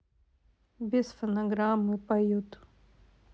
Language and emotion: Russian, sad